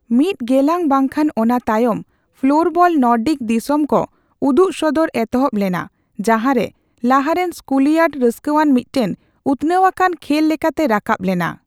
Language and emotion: Santali, neutral